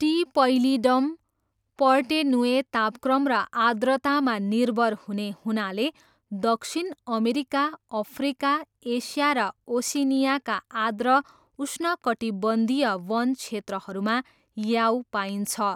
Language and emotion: Nepali, neutral